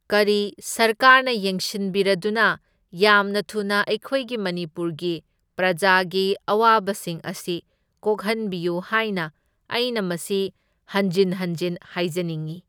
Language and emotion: Manipuri, neutral